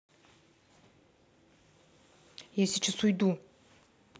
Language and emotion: Russian, angry